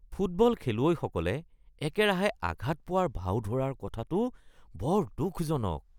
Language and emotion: Assamese, disgusted